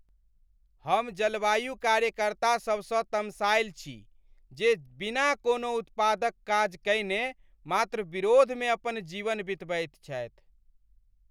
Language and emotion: Maithili, angry